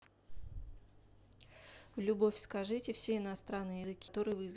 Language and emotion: Russian, neutral